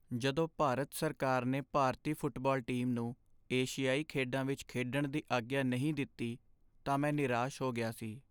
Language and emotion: Punjabi, sad